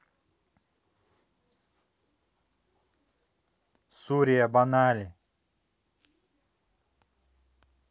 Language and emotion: Russian, neutral